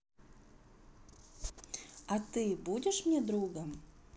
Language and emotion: Russian, neutral